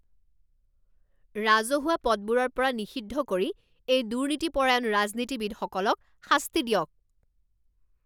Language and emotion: Assamese, angry